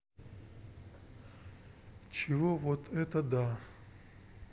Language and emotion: Russian, neutral